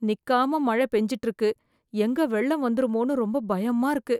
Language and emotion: Tamil, fearful